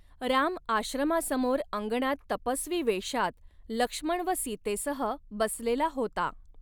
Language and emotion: Marathi, neutral